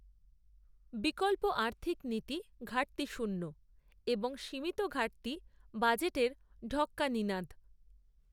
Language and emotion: Bengali, neutral